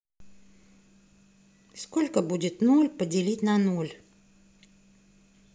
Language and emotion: Russian, neutral